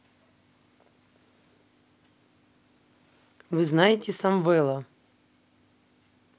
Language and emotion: Russian, neutral